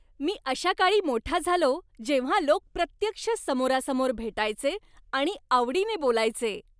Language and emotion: Marathi, happy